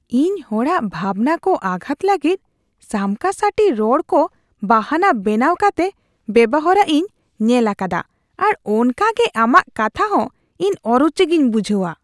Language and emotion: Santali, disgusted